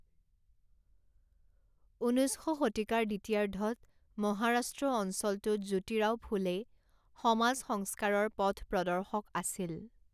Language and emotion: Assamese, neutral